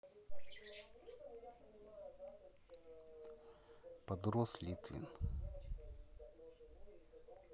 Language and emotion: Russian, neutral